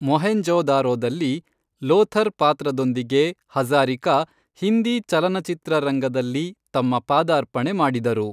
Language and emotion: Kannada, neutral